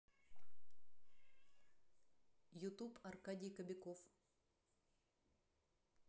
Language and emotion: Russian, neutral